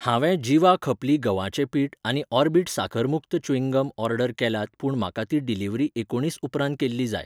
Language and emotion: Goan Konkani, neutral